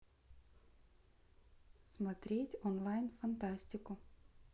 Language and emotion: Russian, neutral